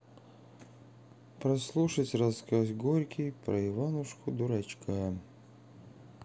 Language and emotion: Russian, sad